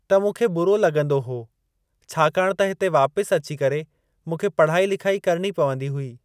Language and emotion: Sindhi, neutral